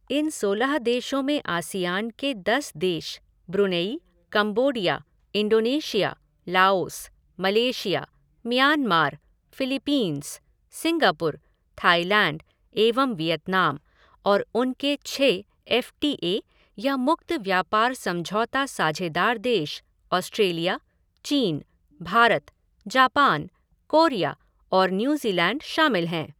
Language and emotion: Hindi, neutral